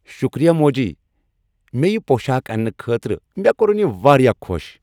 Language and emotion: Kashmiri, happy